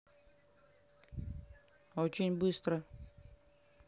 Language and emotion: Russian, neutral